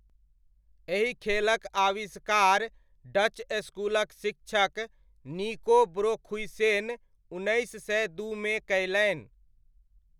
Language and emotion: Maithili, neutral